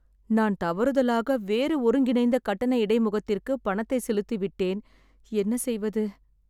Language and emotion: Tamil, sad